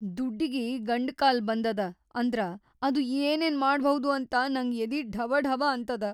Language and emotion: Kannada, fearful